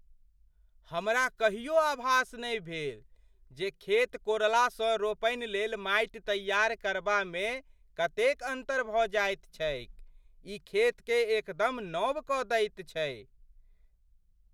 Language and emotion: Maithili, surprised